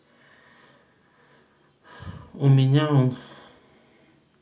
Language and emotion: Russian, sad